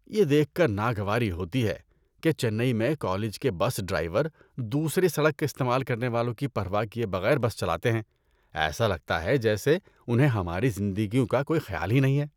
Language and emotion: Urdu, disgusted